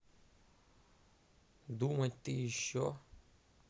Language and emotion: Russian, neutral